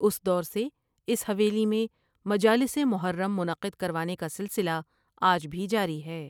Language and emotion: Urdu, neutral